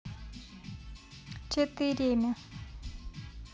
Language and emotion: Russian, neutral